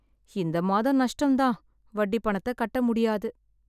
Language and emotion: Tamil, sad